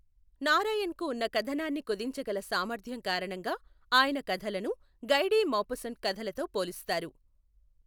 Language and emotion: Telugu, neutral